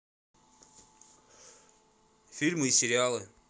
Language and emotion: Russian, neutral